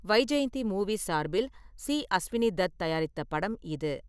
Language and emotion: Tamil, neutral